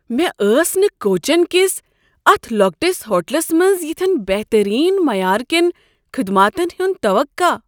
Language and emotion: Kashmiri, surprised